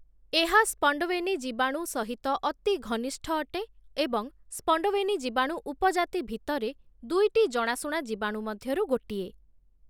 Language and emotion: Odia, neutral